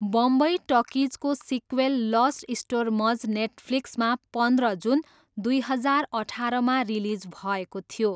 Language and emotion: Nepali, neutral